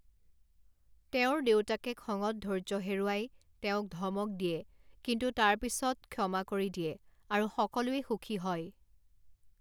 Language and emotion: Assamese, neutral